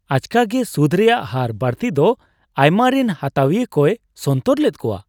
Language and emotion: Santali, surprised